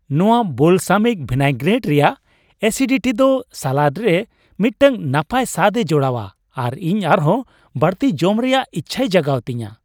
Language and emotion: Santali, happy